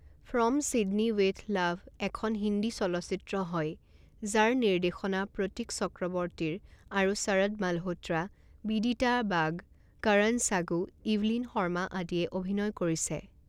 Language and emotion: Assamese, neutral